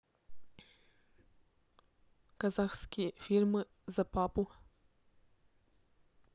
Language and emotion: Russian, neutral